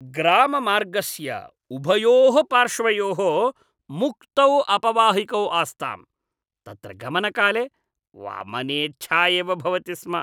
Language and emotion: Sanskrit, disgusted